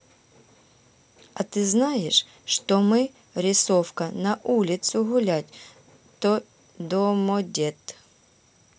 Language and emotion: Russian, neutral